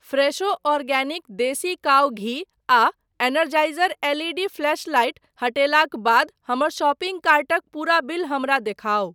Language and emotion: Maithili, neutral